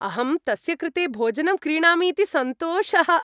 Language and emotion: Sanskrit, happy